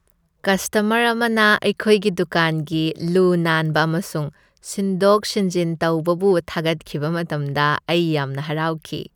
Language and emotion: Manipuri, happy